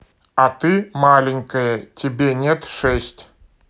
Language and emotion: Russian, neutral